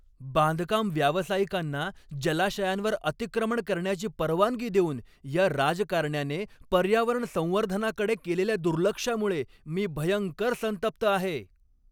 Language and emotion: Marathi, angry